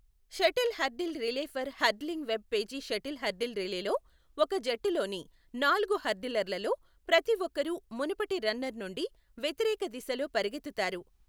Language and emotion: Telugu, neutral